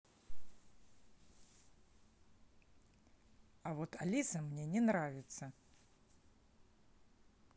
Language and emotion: Russian, angry